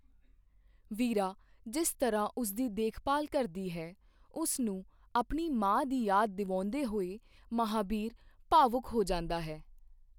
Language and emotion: Punjabi, neutral